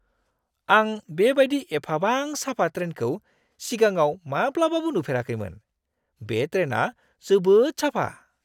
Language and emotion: Bodo, surprised